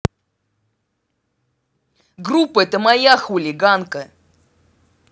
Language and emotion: Russian, angry